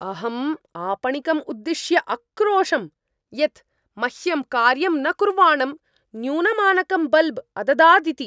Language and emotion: Sanskrit, angry